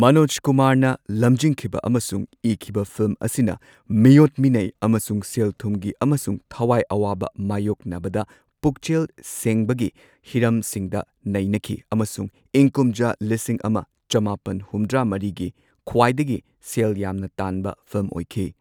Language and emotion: Manipuri, neutral